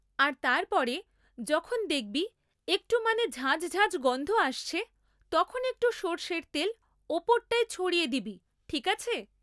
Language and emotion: Bengali, neutral